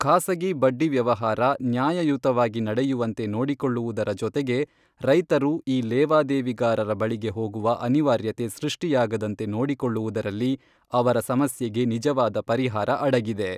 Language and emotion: Kannada, neutral